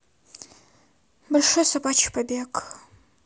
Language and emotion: Russian, neutral